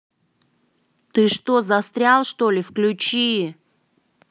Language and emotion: Russian, angry